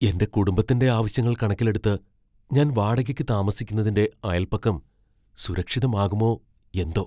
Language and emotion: Malayalam, fearful